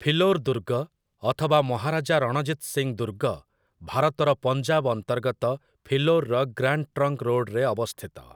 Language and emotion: Odia, neutral